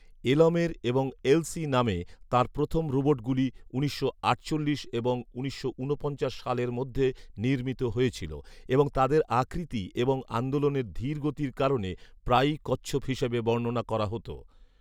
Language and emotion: Bengali, neutral